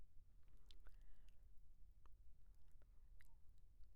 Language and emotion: Assamese, surprised